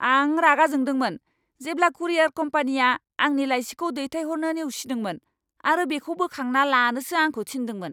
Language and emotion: Bodo, angry